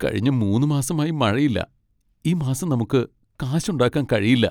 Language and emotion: Malayalam, sad